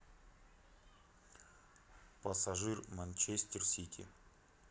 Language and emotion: Russian, neutral